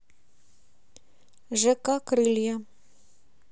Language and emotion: Russian, neutral